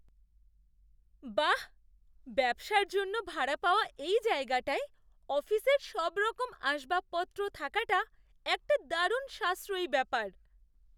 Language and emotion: Bengali, surprised